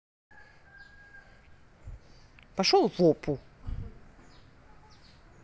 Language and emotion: Russian, angry